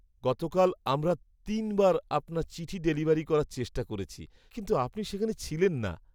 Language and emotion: Bengali, sad